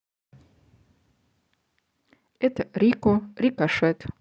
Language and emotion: Russian, neutral